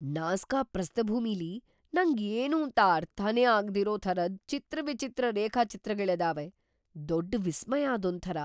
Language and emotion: Kannada, surprised